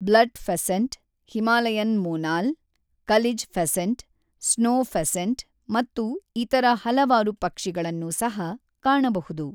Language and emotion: Kannada, neutral